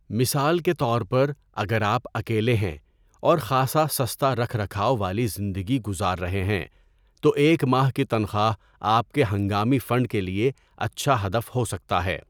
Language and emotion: Urdu, neutral